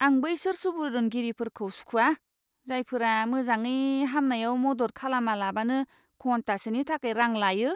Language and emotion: Bodo, disgusted